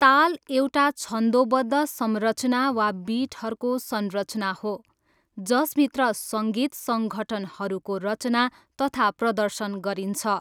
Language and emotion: Nepali, neutral